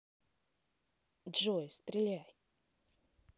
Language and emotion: Russian, neutral